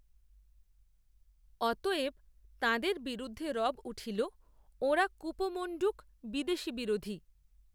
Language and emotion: Bengali, neutral